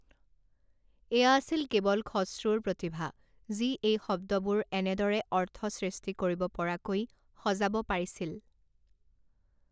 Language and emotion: Assamese, neutral